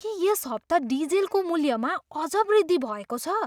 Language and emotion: Nepali, surprised